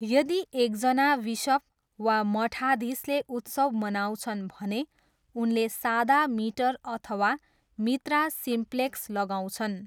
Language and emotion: Nepali, neutral